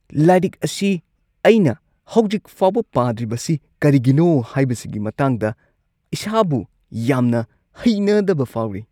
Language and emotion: Manipuri, disgusted